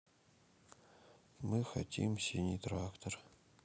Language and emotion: Russian, sad